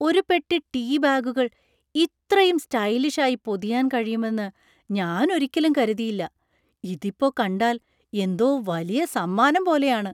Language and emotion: Malayalam, surprised